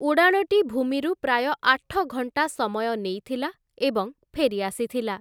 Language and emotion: Odia, neutral